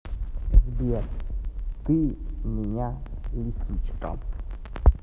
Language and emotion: Russian, neutral